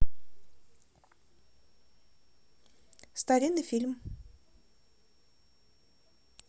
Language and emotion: Russian, neutral